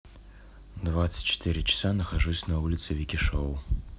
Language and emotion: Russian, neutral